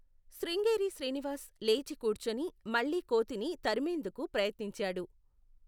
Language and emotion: Telugu, neutral